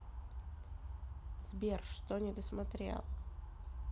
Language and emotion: Russian, neutral